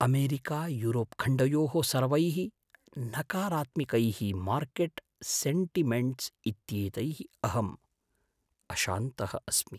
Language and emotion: Sanskrit, fearful